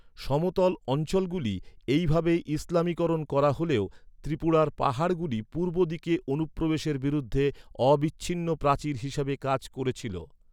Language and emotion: Bengali, neutral